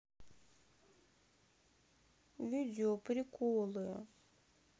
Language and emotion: Russian, sad